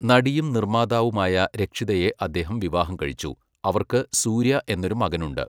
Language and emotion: Malayalam, neutral